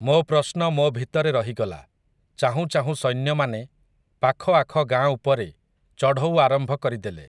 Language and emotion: Odia, neutral